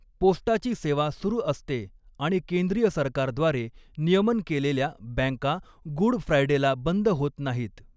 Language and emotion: Marathi, neutral